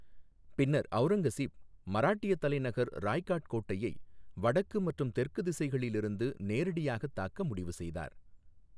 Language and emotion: Tamil, neutral